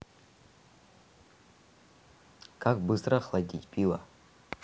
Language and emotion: Russian, neutral